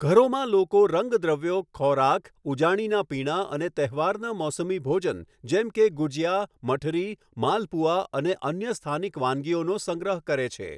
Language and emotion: Gujarati, neutral